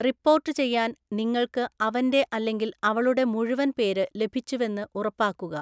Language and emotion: Malayalam, neutral